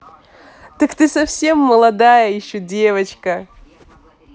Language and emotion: Russian, positive